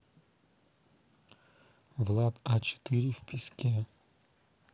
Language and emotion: Russian, neutral